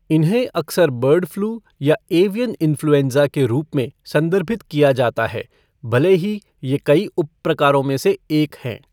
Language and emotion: Hindi, neutral